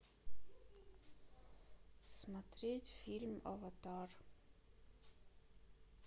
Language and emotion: Russian, neutral